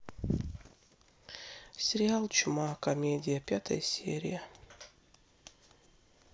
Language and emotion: Russian, sad